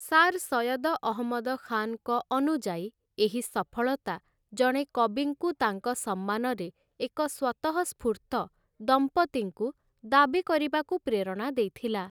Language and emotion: Odia, neutral